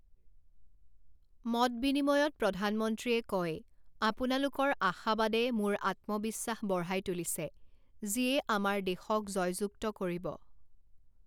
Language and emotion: Assamese, neutral